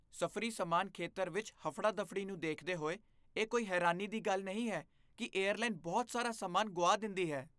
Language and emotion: Punjabi, disgusted